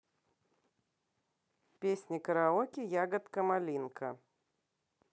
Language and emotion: Russian, neutral